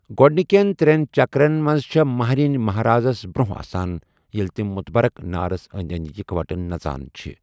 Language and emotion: Kashmiri, neutral